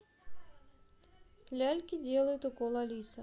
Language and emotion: Russian, neutral